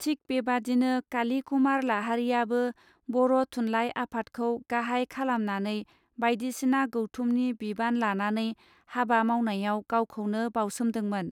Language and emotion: Bodo, neutral